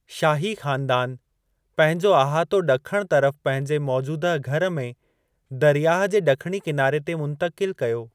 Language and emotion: Sindhi, neutral